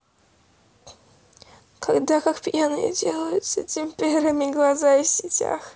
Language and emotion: Russian, sad